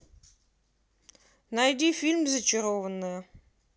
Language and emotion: Russian, neutral